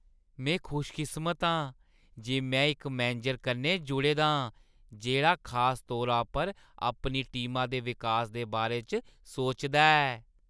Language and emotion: Dogri, happy